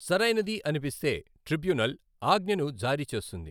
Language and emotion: Telugu, neutral